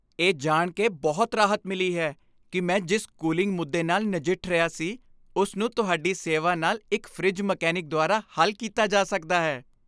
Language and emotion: Punjabi, happy